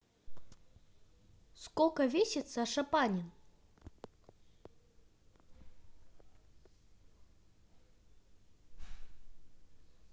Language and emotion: Russian, positive